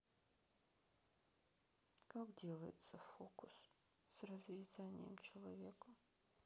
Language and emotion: Russian, sad